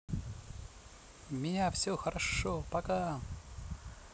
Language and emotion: Russian, positive